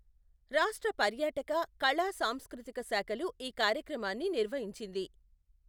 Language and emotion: Telugu, neutral